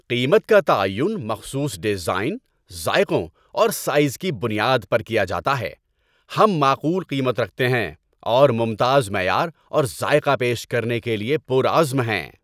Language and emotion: Urdu, happy